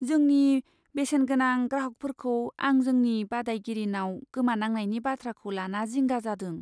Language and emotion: Bodo, fearful